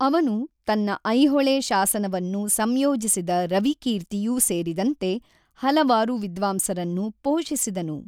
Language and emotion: Kannada, neutral